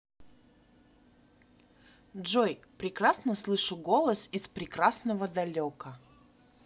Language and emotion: Russian, positive